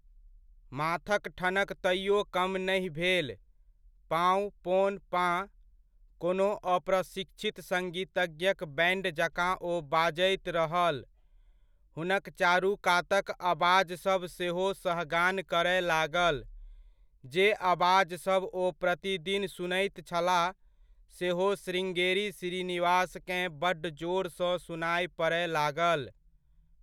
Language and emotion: Maithili, neutral